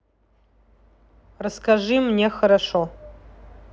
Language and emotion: Russian, neutral